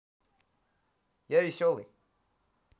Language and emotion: Russian, positive